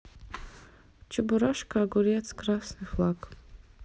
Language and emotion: Russian, neutral